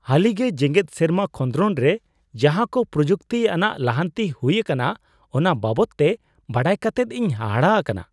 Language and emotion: Santali, surprised